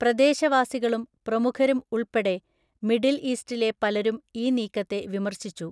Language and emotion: Malayalam, neutral